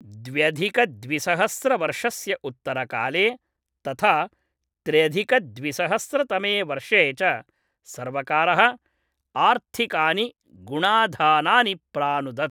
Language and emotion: Sanskrit, neutral